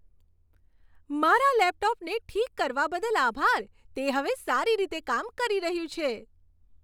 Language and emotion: Gujarati, happy